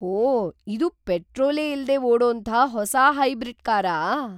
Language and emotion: Kannada, surprised